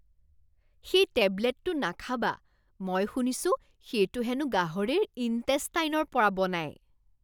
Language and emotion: Assamese, disgusted